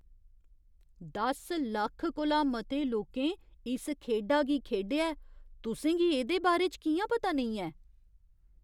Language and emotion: Dogri, surprised